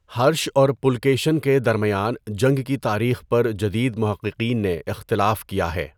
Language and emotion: Urdu, neutral